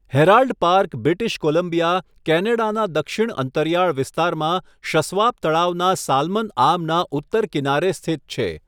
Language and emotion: Gujarati, neutral